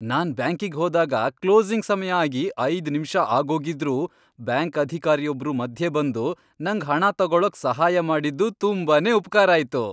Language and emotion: Kannada, happy